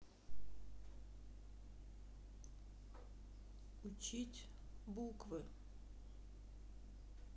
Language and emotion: Russian, sad